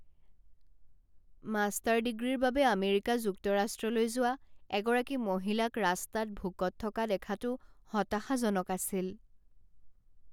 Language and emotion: Assamese, sad